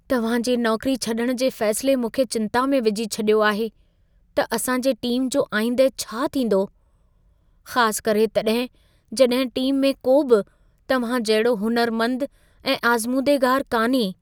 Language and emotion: Sindhi, fearful